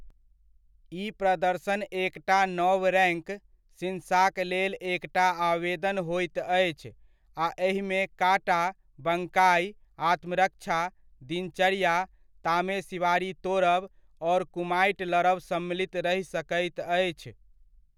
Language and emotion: Maithili, neutral